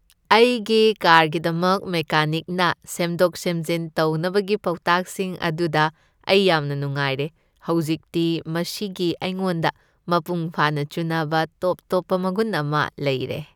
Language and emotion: Manipuri, happy